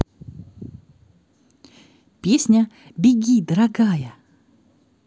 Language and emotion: Russian, positive